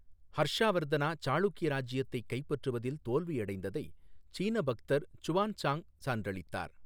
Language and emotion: Tamil, neutral